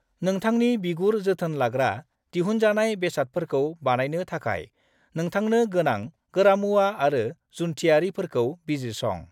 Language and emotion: Bodo, neutral